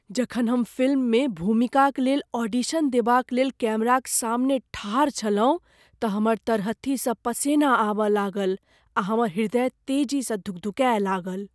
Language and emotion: Maithili, fearful